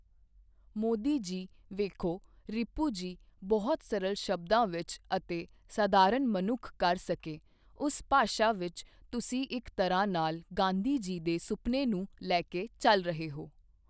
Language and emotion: Punjabi, neutral